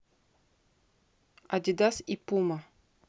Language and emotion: Russian, neutral